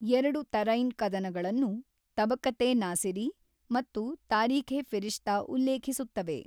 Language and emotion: Kannada, neutral